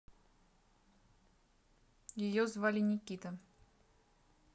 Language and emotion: Russian, neutral